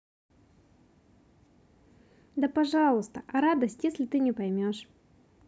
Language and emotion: Russian, positive